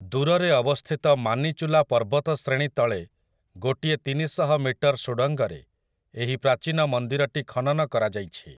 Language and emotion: Odia, neutral